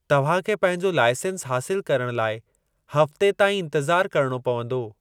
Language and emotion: Sindhi, neutral